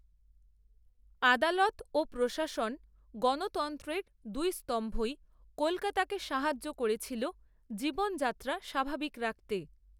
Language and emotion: Bengali, neutral